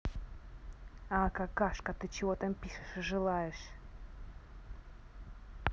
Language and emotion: Russian, angry